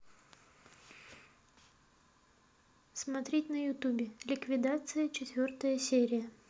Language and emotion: Russian, neutral